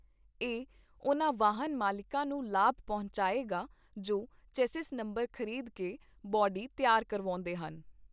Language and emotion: Punjabi, neutral